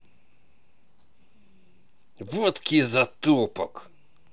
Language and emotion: Russian, angry